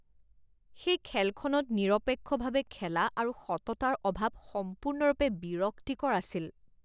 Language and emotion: Assamese, disgusted